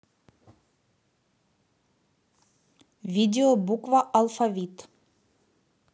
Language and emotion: Russian, neutral